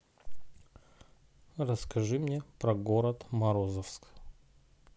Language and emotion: Russian, neutral